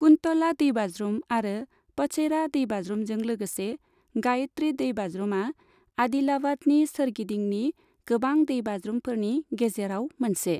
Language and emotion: Bodo, neutral